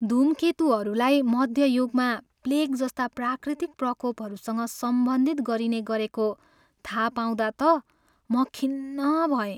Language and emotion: Nepali, sad